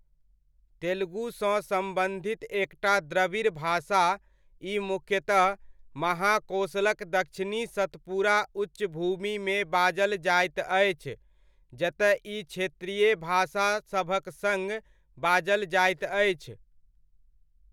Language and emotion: Maithili, neutral